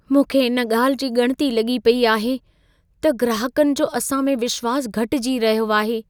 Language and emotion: Sindhi, fearful